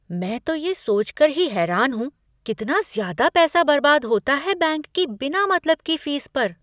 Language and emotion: Hindi, surprised